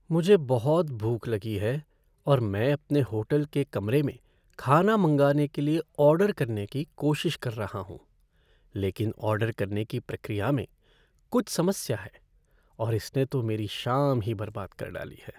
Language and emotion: Hindi, sad